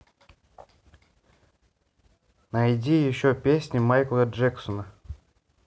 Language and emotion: Russian, neutral